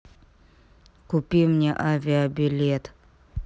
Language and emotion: Russian, angry